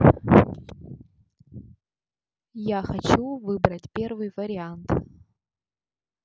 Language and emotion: Russian, neutral